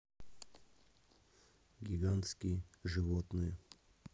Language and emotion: Russian, neutral